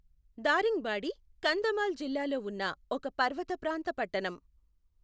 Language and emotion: Telugu, neutral